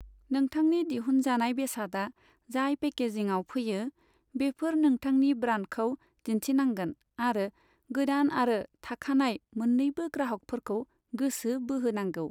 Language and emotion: Bodo, neutral